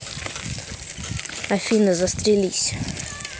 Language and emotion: Russian, angry